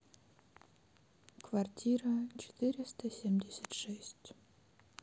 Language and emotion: Russian, neutral